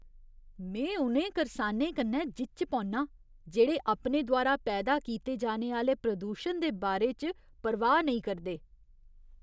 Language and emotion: Dogri, disgusted